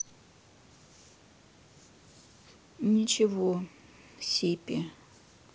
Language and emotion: Russian, sad